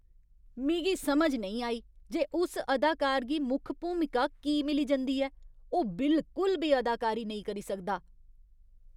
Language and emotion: Dogri, disgusted